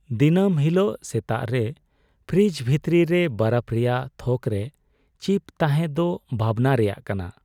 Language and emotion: Santali, sad